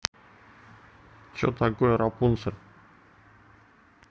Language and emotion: Russian, neutral